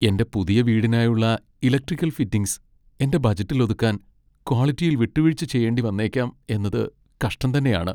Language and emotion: Malayalam, sad